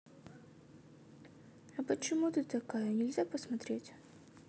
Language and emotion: Russian, sad